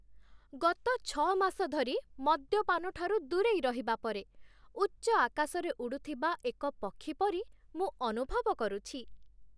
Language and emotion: Odia, happy